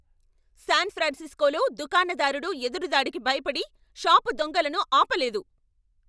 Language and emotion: Telugu, angry